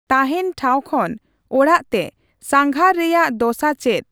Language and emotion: Santali, neutral